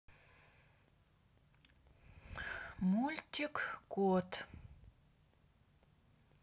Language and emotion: Russian, neutral